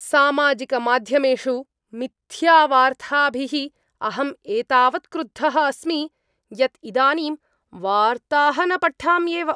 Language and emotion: Sanskrit, angry